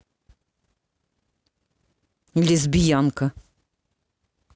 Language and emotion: Russian, angry